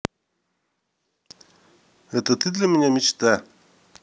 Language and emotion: Russian, neutral